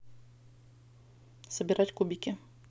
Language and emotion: Russian, neutral